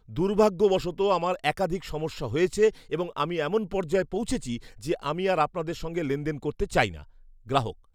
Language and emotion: Bengali, disgusted